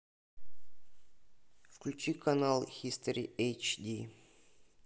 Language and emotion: Russian, neutral